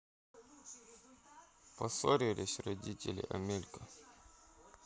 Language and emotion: Russian, sad